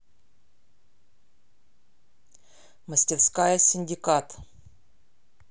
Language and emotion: Russian, neutral